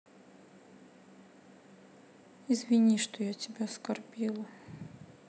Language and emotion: Russian, sad